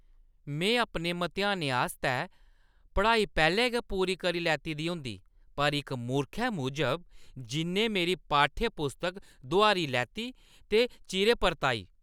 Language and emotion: Dogri, angry